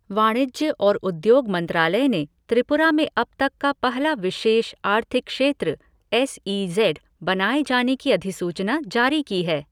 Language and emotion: Hindi, neutral